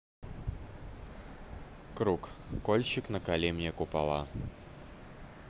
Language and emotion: Russian, neutral